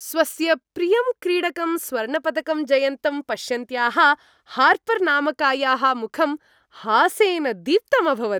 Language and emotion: Sanskrit, happy